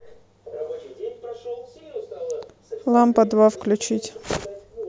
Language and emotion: Russian, neutral